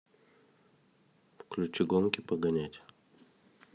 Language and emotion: Russian, neutral